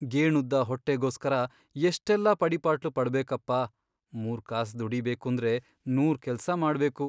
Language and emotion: Kannada, sad